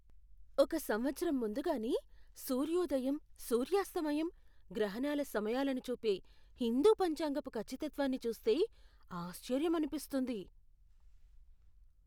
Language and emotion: Telugu, surprised